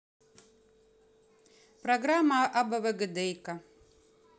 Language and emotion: Russian, neutral